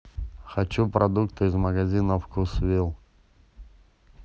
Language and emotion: Russian, neutral